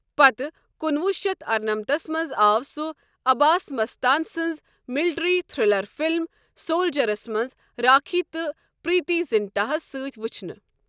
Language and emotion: Kashmiri, neutral